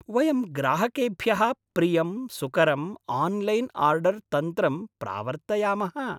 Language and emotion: Sanskrit, happy